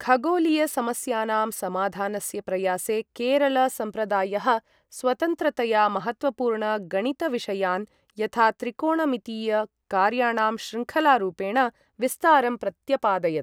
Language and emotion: Sanskrit, neutral